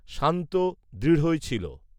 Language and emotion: Bengali, neutral